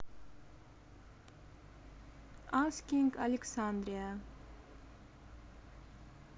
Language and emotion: Russian, neutral